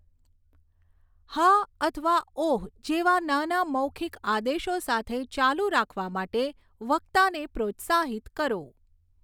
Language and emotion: Gujarati, neutral